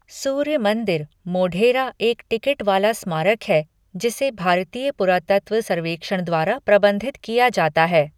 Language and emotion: Hindi, neutral